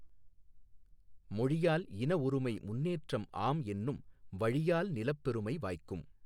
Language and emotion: Tamil, neutral